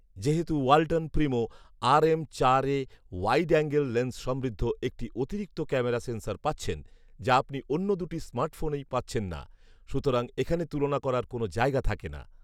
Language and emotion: Bengali, neutral